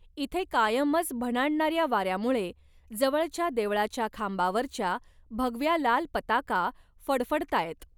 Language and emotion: Marathi, neutral